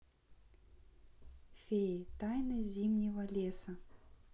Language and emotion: Russian, neutral